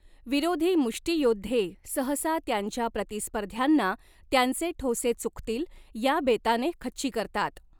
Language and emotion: Marathi, neutral